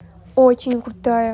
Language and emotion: Russian, positive